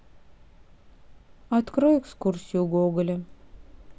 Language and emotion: Russian, sad